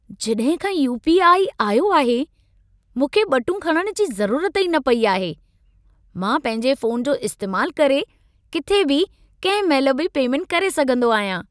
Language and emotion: Sindhi, happy